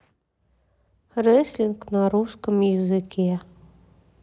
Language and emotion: Russian, sad